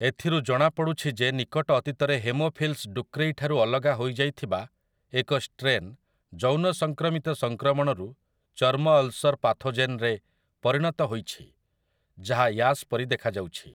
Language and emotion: Odia, neutral